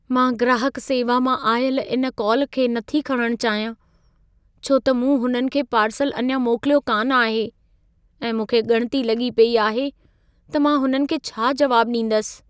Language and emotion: Sindhi, fearful